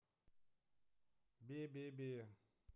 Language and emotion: Russian, neutral